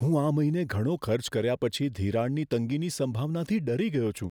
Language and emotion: Gujarati, fearful